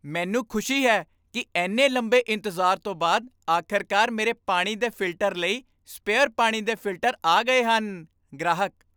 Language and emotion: Punjabi, happy